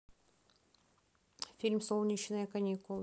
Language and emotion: Russian, neutral